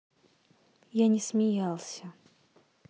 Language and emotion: Russian, sad